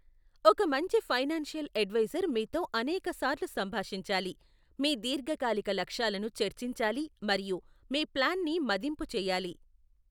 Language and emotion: Telugu, neutral